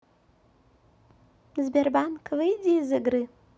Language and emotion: Russian, neutral